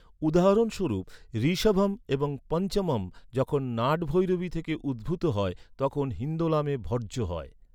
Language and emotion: Bengali, neutral